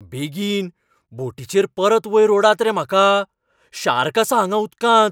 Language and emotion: Goan Konkani, fearful